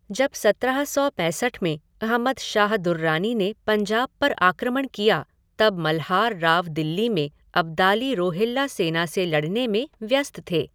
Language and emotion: Hindi, neutral